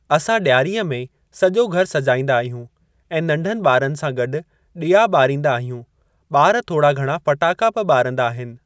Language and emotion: Sindhi, neutral